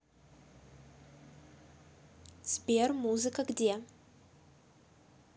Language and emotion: Russian, neutral